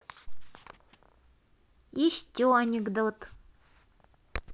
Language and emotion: Russian, positive